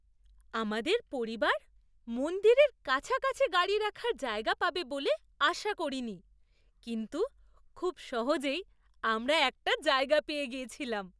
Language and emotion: Bengali, surprised